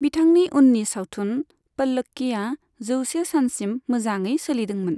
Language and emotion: Bodo, neutral